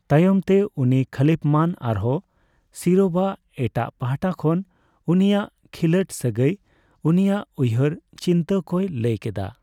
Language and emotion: Santali, neutral